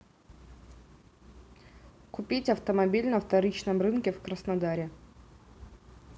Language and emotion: Russian, neutral